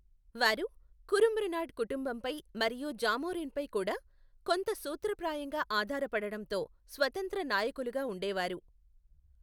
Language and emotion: Telugu, neutral